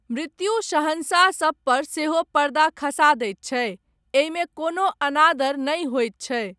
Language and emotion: Maithili, neutral